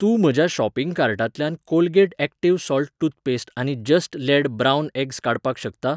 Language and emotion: Goan Konkani, neutral